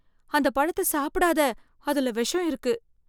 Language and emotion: Tamil, fearful